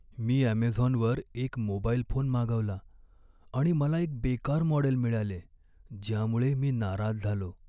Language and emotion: Marathi, sad